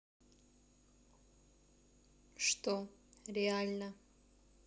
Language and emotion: Russian, neutral